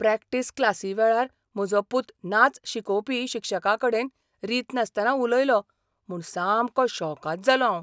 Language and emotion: Goan Konkani, surprised